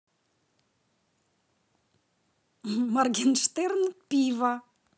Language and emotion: Russian, positive